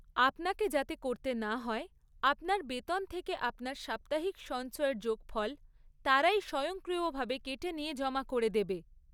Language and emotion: Bengali, neutral